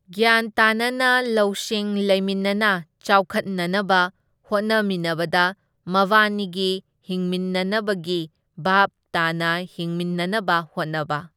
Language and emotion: Manipuri, neutral